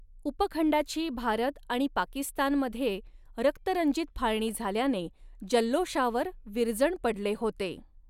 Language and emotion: Marathi, neutral